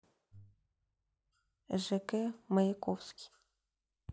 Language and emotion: Russian, neutral